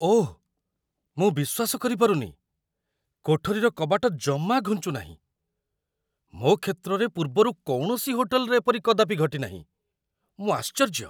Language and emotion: Odia, surprised